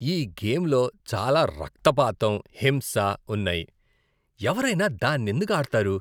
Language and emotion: Telugu, disgusted